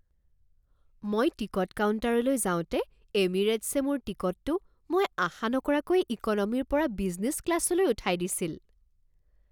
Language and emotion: Assamese, surprised